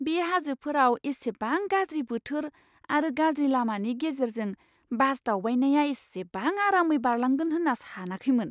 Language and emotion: Bodo, surprised